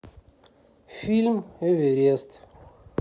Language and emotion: Russian, neutral